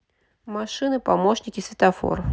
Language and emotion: Russian, neutral